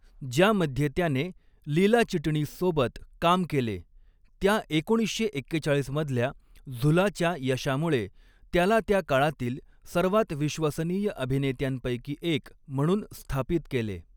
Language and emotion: Marathi, neutral